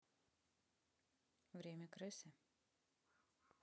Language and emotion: Russian, neutral